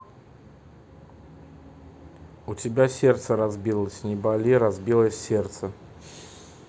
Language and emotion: Russian, neutral